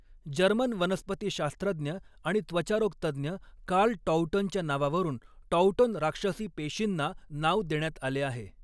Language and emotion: Marathi, neutral